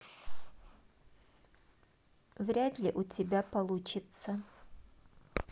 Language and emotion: Russian, neutral